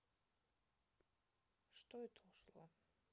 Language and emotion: Russian, neutral